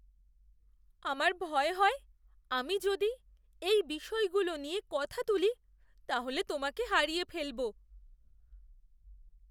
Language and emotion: Bengali, fearful